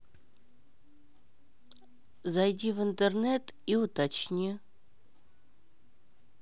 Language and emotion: Russian, neutral